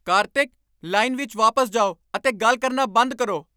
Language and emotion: Punjabi, angry